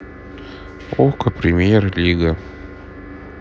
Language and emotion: Russian, neutral